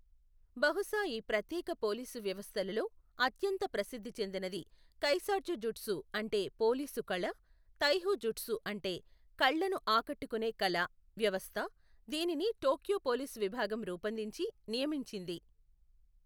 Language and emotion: Telugu, neutral